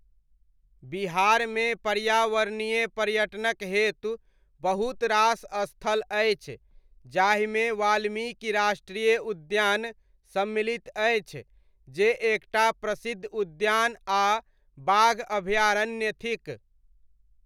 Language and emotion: Maithili, neutral